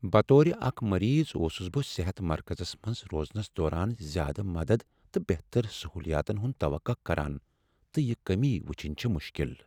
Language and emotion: Kashmiri, sad